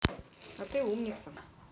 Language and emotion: Russian, neutral